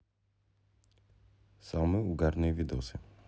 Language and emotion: Russian, neutral